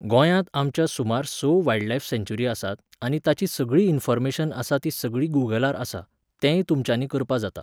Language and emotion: Goan Konkani, neutral